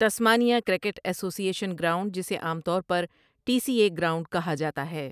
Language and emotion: Urdu, neutral